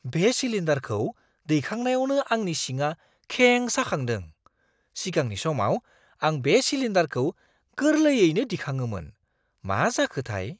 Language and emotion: Bodo, surprised